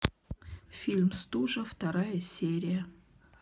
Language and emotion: Russian, neutral